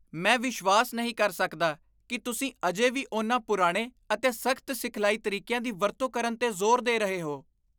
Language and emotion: Punjabi, disgusted